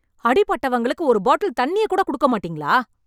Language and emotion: Tamil, angry